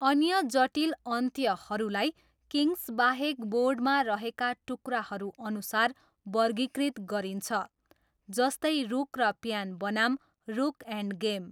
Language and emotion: Nepali, neutral